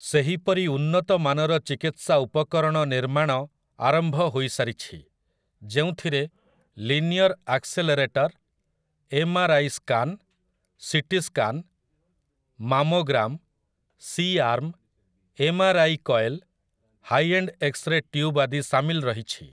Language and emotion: Odia, neutral